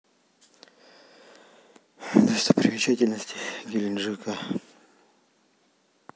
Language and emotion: Russian, sad